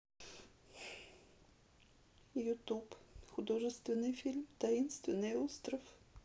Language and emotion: Russian, sad